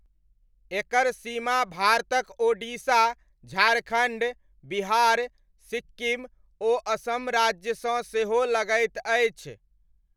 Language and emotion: Maithili, neutral